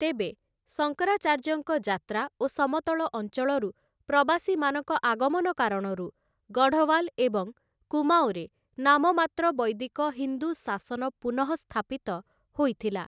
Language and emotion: Odia, neutral